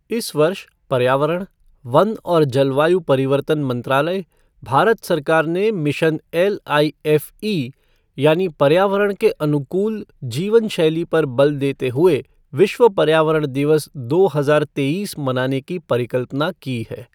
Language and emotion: Hindi, neutral